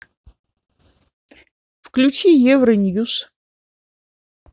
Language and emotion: Russian, neutral